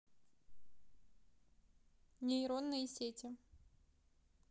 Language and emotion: Russian, neutral